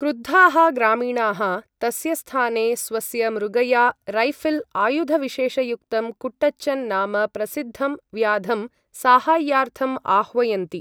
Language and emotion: Sanskrit, neutral